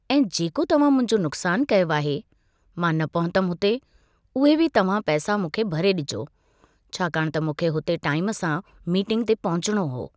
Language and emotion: Sindhi, neutral